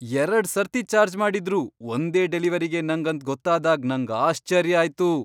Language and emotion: Kannada, surprised